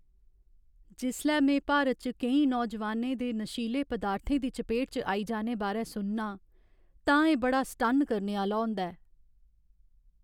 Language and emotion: Dogri, sad